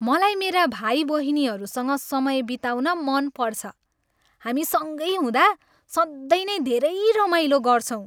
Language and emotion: Nepali, happy